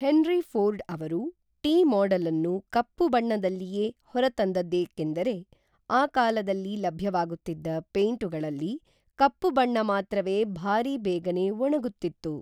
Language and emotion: Kannada, neutral